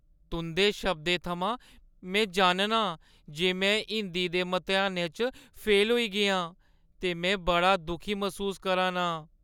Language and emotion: Dogri, sad